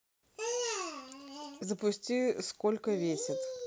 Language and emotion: Russian, neutral